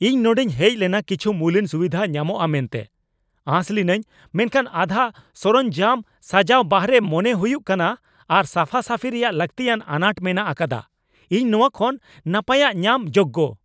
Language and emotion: Santali, angry